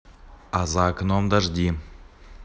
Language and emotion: Russian, neutral